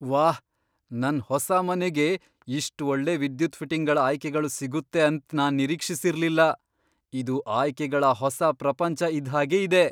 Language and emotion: Kannada, surprised